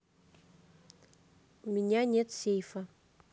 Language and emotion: Russian, neutral